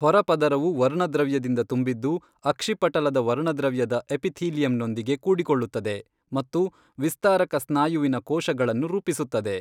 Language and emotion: Kannada, neutral